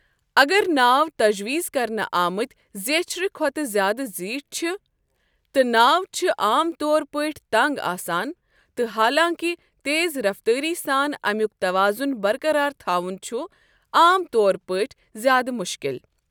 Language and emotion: Kashmiri, neutral